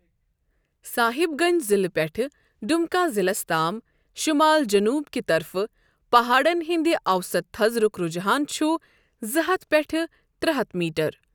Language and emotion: Kashmiri, neutral